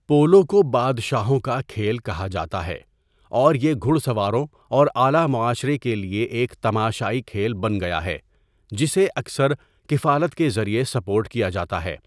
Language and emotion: Urdu, neutral